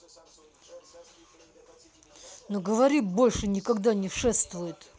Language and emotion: Russian, angry